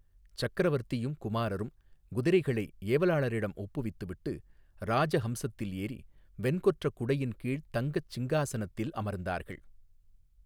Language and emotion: Tamil, neutral